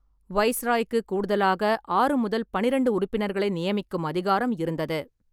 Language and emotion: Tamil, neutral